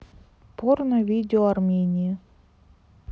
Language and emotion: Russian, neutral